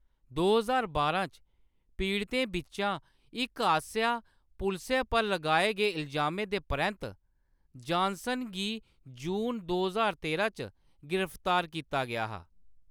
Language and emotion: Dogri, neutral